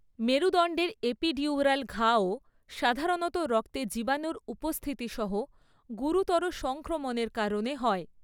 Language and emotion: Bengali, neutral